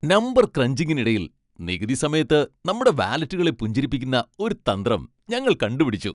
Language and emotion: Malayalam, happy